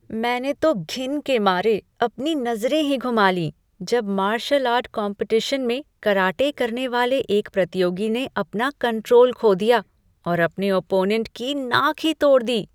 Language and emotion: Hindi, disgusted